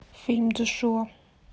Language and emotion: Russian, neutral